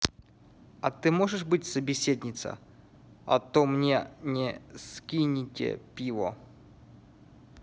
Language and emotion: Russian, neutral